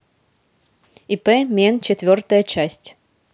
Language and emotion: Russian, neutral